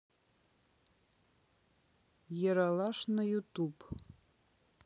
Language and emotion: Russian, neutral